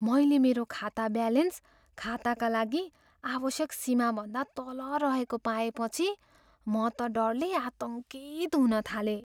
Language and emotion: Nepali, fearful